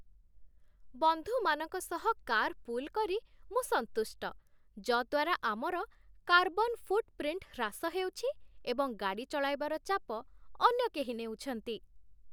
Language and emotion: Odia, happy